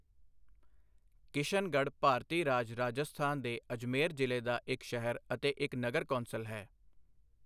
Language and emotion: Punjabi, neutral